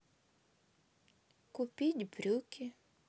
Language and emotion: Russian, sad